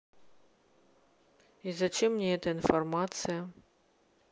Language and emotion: Russian, neutral